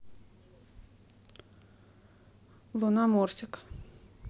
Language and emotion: Russian, neutral